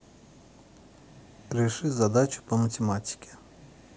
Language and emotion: Russian, neutral